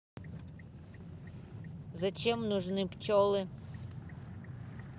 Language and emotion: Russian, neutral